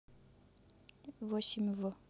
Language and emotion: Russian, neutral